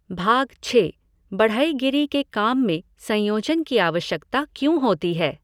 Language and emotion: Hindi, neutral